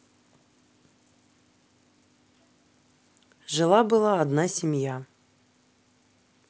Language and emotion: Russian, neutral